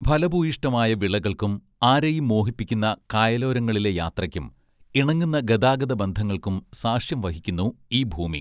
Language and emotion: Malayalam, neutral